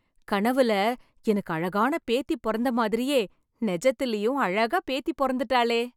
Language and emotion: Tamil, happy